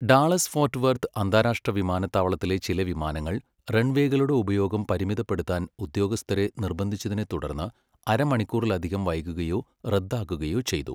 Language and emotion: Malayalam, neutral